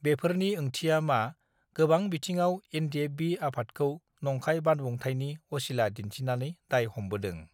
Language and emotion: Bodo, neutral